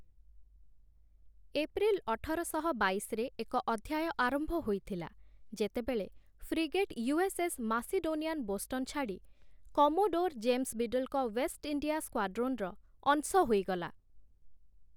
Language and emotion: Odia, neutral